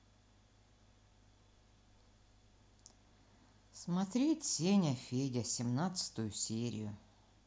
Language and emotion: Russian, sad